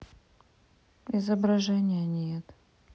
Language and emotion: Russian, sad